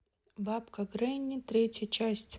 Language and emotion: Russian, neutral